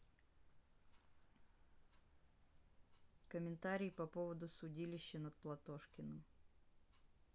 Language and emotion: Russian, neutral